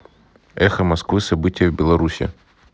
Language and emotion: Russian, neutral